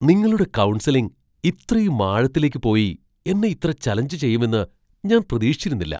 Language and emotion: Malayalam, surprised